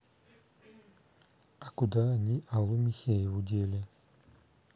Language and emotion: Russian, neutral